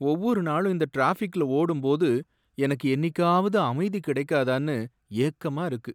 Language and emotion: Tamil, sad